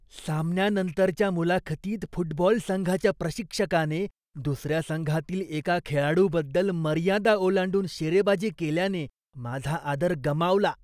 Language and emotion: Marathi, disgusted